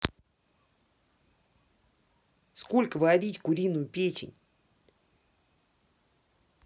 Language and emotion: Russian, angry